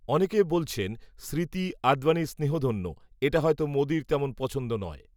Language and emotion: Bengali, neutral